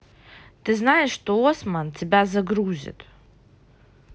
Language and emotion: Russian, neutral